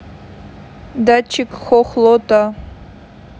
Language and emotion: Russian, neutral